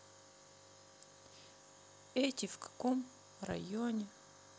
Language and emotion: Russian, sad